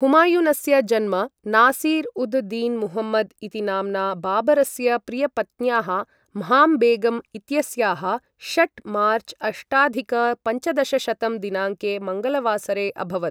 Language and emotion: Sanskrit, neutral